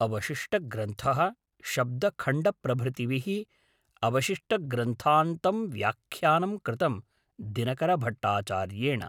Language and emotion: Sanskrit, neutral